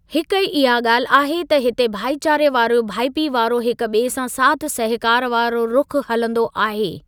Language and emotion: Sindhi, neutral